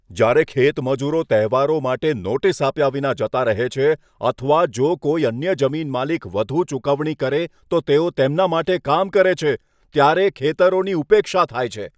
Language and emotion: Gujarati, angry